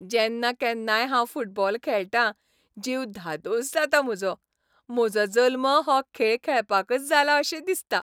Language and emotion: Goan Konkani, happy